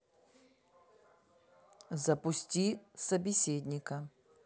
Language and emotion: Russian, neutral